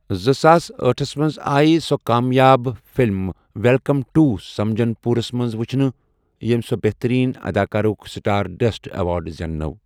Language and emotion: Kashmiri, neutral